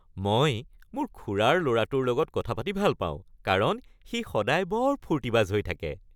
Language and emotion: Assamese, happy